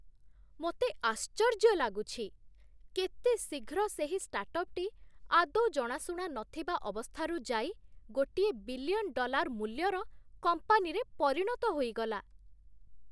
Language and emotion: Odia, surprised